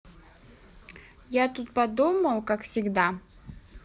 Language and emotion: Russian, neutral